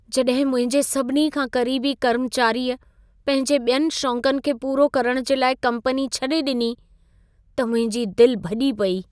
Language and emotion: Sindhi, sad